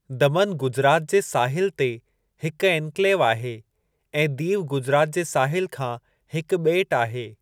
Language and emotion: Sindhi, neutral